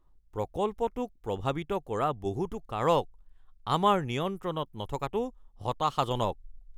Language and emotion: Assamese, angry